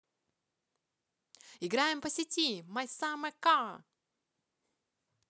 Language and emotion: Russian, positive